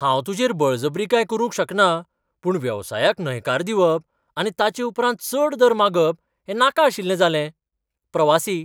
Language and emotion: Goan Konkani, surprised